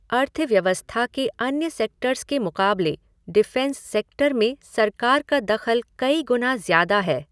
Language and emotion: Hindi, neutral